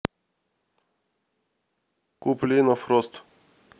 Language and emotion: Russian, neutral